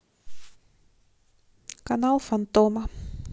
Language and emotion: Russian, neutral